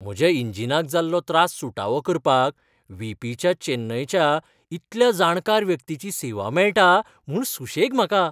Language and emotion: Goan Konkani, happy